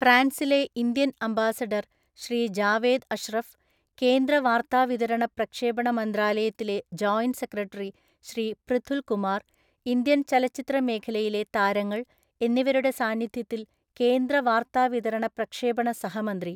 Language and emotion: Malayalam, neutral